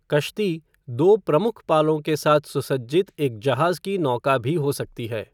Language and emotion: Hindi, neutral